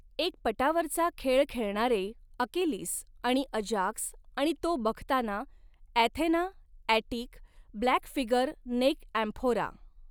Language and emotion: Marathi, neutral